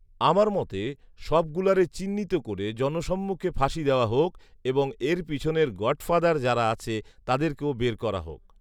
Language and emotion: Bengali, neutral